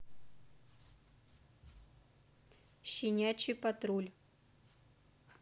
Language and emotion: Russian, neutral